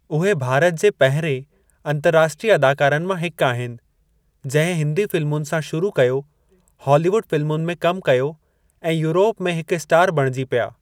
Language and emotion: Sindhi, neutral